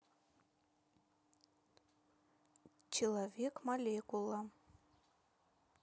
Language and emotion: Russian, neutral